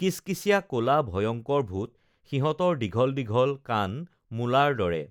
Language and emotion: Assamese, neutral